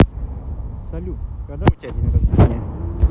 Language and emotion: Russian, neutral